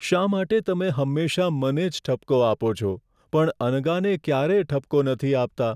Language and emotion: Gujarati, sad